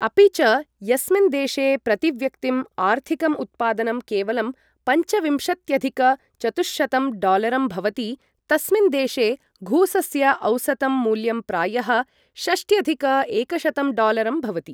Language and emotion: Sanskrit, neutral